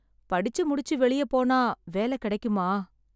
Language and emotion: Tamil, sad